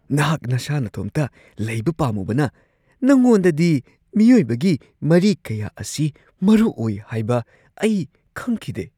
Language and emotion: Manipuri, surprised